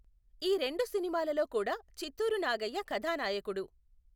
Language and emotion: Telugu, neutral